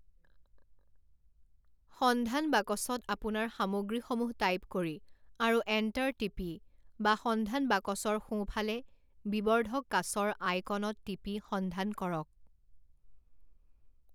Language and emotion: Assamese, neutral